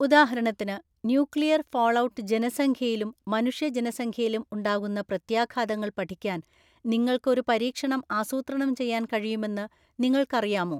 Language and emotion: Malayalam, neutral